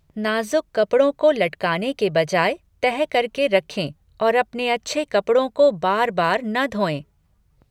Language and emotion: Hindi, neutral